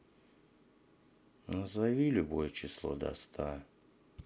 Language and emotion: Russian, sad